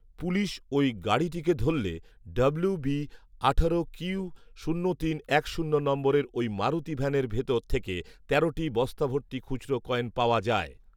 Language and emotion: Bengali, neutral